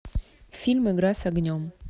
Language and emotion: Russian, neutral